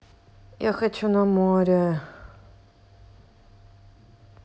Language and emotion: Russian, sad